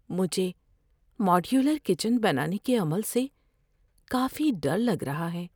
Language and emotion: Urdu, fearful